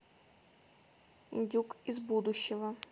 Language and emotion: Russian, neutral